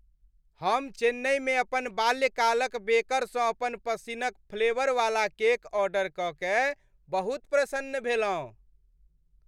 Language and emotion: Maithili, happy